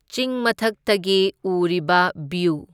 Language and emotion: Manipuri, neutral